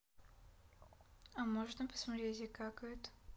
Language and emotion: Russian, neutral